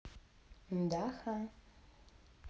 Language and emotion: Russian, positive